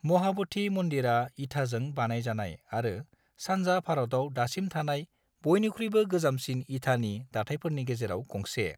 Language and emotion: Bodo, neutral